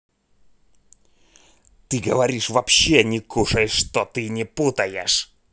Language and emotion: Russian, angry